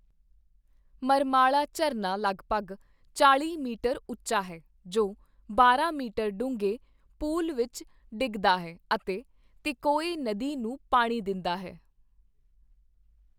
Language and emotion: Punjabi, neutral